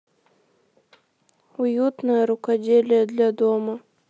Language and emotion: Russian, sad